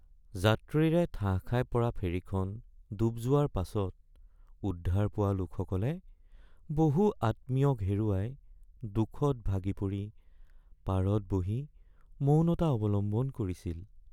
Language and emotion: Assamese, sad